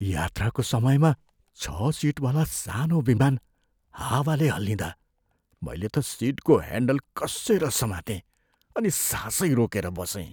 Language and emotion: Nepali, fearful